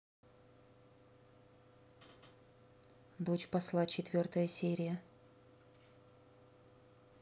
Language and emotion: Russian, neutral